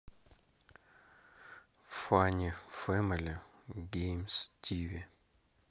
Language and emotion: Russian, neutral